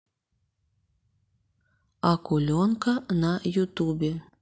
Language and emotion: Russian, neutral